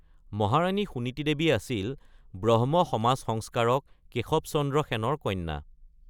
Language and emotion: Assamese, neutral